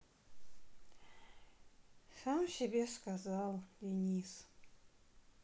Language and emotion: Russian, sad